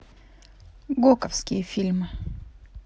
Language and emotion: Russian, neutral